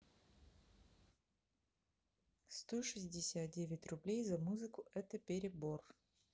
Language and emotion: Russian, neutral